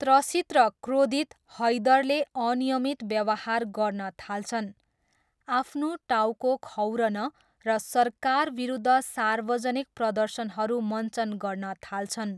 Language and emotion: Nepali, neutral